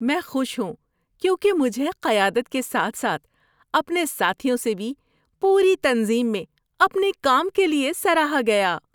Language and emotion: Urdu, happy